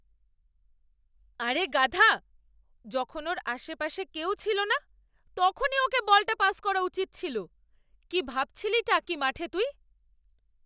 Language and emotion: Bengali, angry